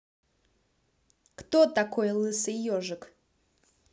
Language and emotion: Russian, neutral